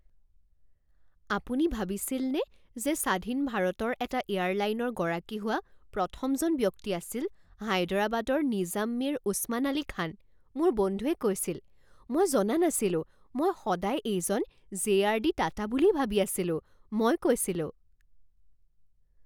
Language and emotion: Assamese, surprised